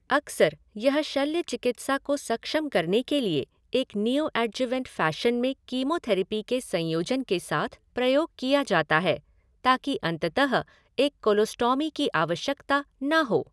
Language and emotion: Hindi, neutral